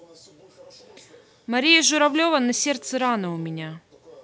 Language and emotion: Russian, neutral